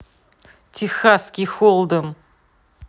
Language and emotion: Russian, angry